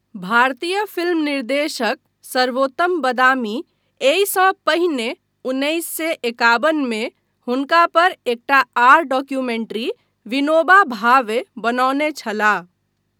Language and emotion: Maithili, neutral